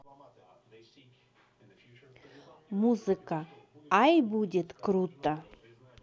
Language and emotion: Russian, positive